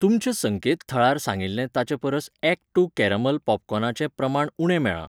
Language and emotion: Goan Konkani, neutral